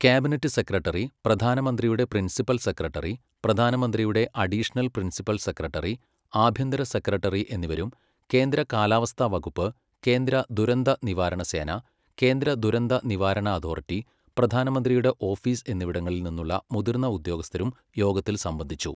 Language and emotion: Malayalam, neutral